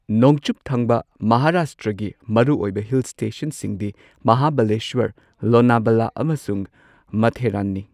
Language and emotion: Manipuri, neutral